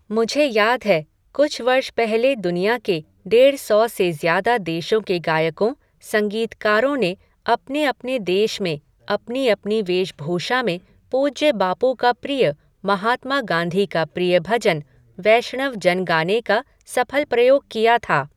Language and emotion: Hindi, neutral